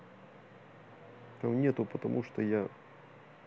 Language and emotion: Russian, neutral